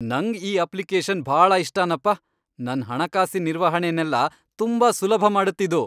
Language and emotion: Kannada, happy